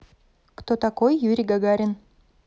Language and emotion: Russian, neutral